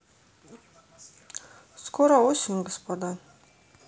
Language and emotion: Russian, neutral